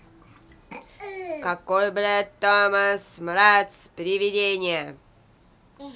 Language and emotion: Russian, angry